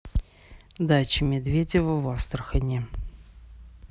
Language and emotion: Russian, neutral